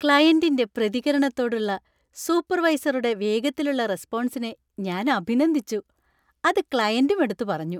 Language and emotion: Malayalam, happy